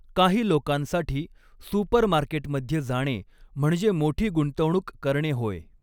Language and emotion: Marathi, neutral